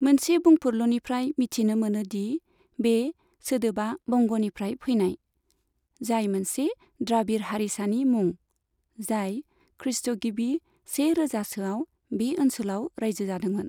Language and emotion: Bodo, neutral